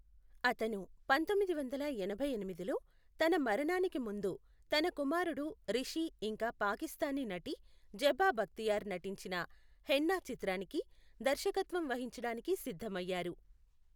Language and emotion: Telugu, neutral